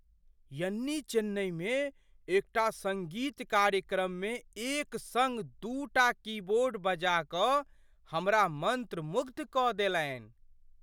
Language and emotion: Maithili, surprised